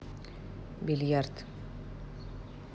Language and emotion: Russian, neutral